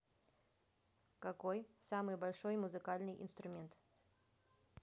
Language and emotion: Russian, neutral